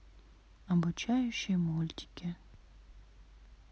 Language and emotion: Russian, sad